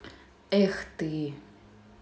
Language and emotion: Russian, sad